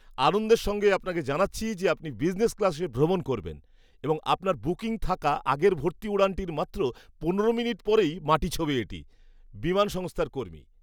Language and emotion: Bengali, happy